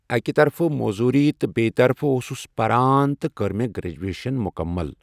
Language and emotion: Kashmiri, neutral